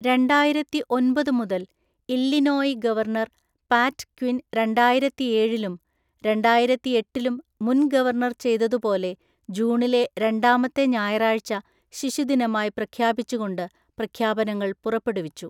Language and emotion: Malayalam, neutral